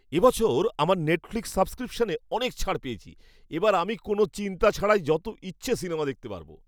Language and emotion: Bengali, happy